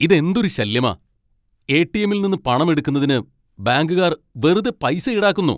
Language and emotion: Malayalam, angry